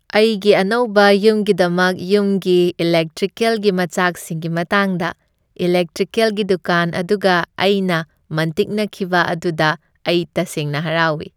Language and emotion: Manipuri, happy